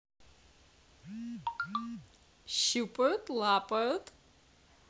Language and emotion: Russian, positive